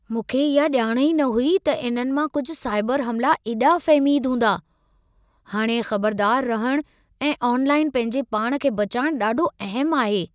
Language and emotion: Sindhi, surprised